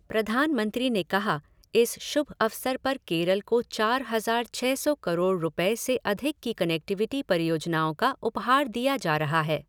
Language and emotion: Hindi, neutral